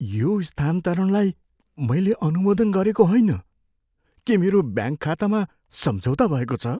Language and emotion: Nepali, fearful